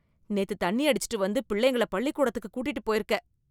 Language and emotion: Tamil, disgusted